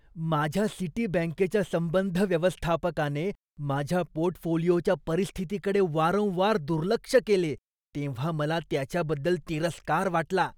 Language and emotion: Marathi, disgusted